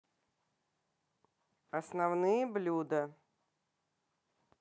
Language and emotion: Russian, neutral